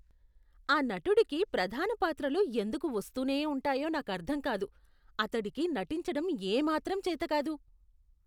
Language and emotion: Telugu, disgusted